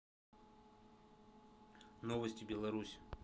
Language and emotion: Russian, neutral